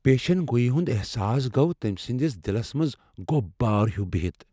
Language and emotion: Kashmiri, fearful